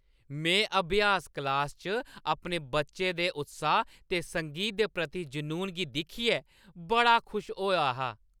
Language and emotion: Dogri, happy